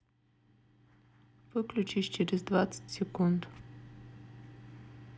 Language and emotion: Russian, neutral